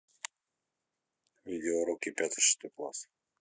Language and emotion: Russian, neutral